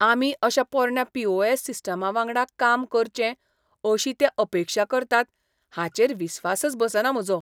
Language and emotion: Goan Konkani, disgusted